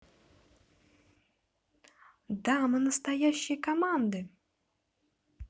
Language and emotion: Russian, positive